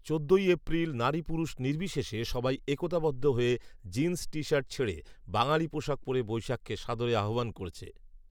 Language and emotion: Bengali, neutral